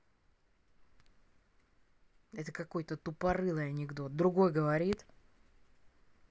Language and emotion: Russian, angry